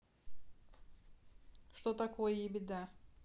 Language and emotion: Russian, neutral